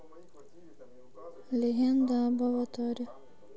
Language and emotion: Russian, neutral